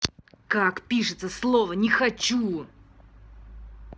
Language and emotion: Russian, angry